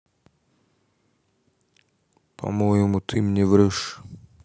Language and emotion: Russian, neutral